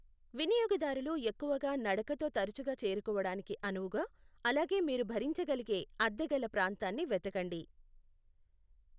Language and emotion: Telugu, neutral